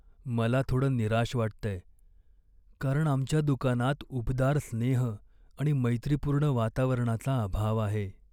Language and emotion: Marathi, sad